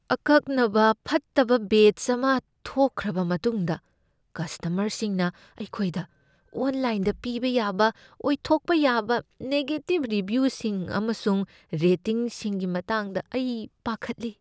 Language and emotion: Manipuri, fearful